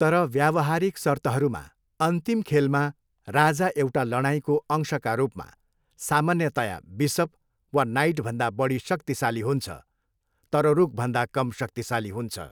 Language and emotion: Nepali, neutral